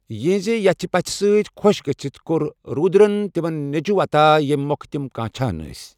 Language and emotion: Kashmiri, neutral